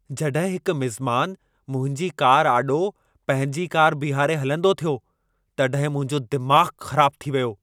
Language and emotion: Sindhi, angry